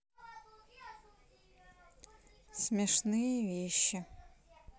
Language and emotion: Russian, neutral